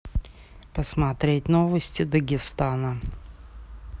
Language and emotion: Russian, neutral